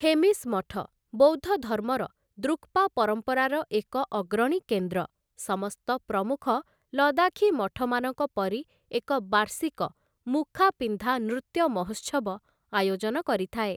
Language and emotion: Odia, neutral